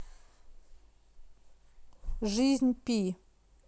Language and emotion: Russian, neutral